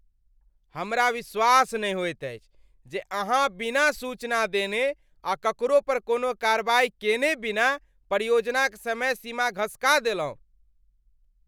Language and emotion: Maithili, angry